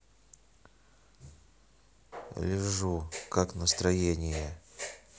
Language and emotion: Russian, neutral